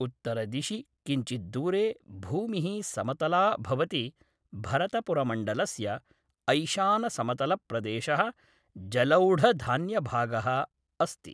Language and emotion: Sanskrit, neutral